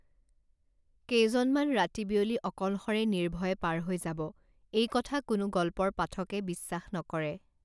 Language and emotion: Assamese, neutral